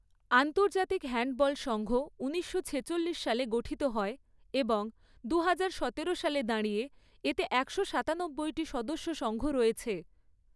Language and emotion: Bengali, neutral